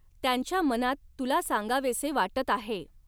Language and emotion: Marathi, neutral